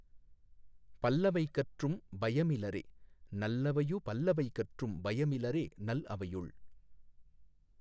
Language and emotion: Tamil, neutral